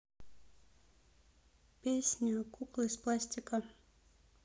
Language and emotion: Russian, neutral